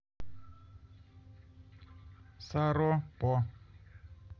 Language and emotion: Russian, neutral